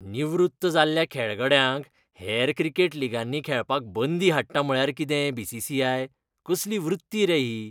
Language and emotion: Goan Konkani, disgusted